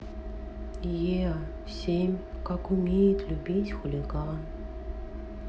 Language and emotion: Russian, sad